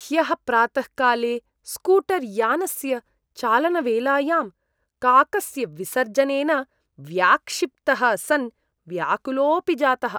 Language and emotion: Sanskrit, disgusted